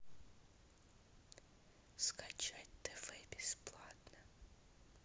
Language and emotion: Russian, neutral